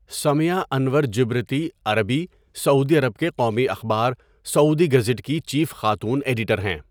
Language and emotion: Urdu, neutral